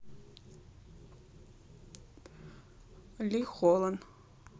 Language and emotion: Russian, neutral